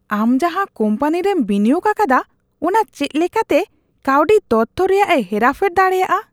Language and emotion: Santali, disgusted